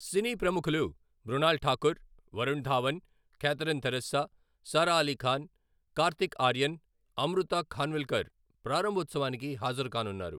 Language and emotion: Telugu, neutral